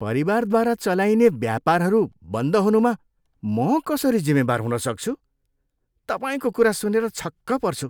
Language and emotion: Nepali, disgusted